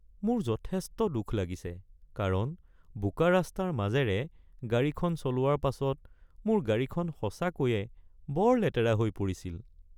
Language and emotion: Assamese, sad